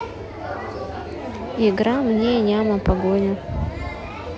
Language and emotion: Russian, neutral